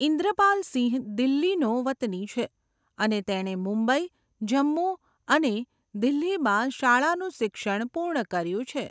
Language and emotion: Gujarati, neutral